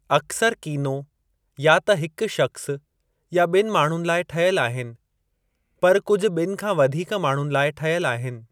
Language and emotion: Sindhi, neutral